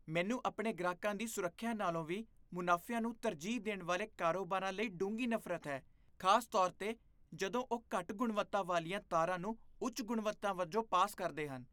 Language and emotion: Punjabi, disgusted